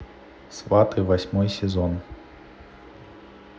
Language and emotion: Russian, neutral